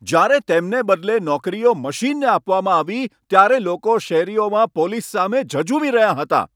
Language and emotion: Gujarati, angry